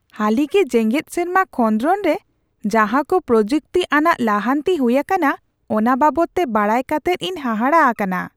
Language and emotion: Santali, surprised